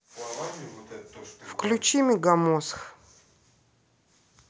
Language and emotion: Russian, neutral